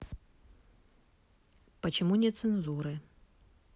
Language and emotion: Russian, neutral